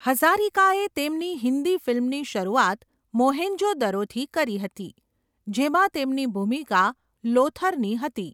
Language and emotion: Gujarati, neutral